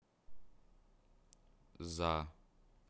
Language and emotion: Russian, neutral